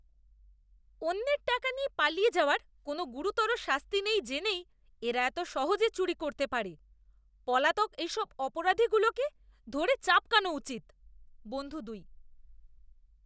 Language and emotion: Bengali, disgusted